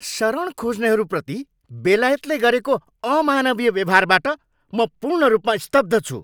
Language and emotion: Nepali, angry